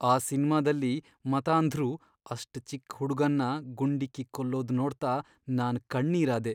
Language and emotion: Kannada, sad